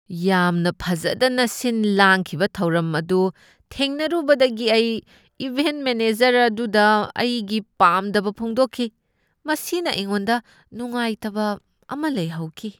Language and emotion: Manipuri, disgusted